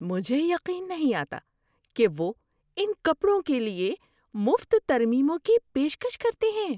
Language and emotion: Urdu, surprised